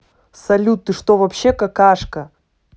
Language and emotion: Russian, angry